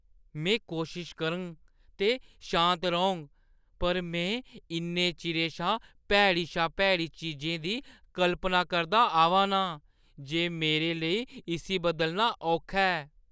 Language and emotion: Dogri, disgusted